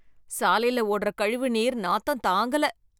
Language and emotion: Tamil, disgusted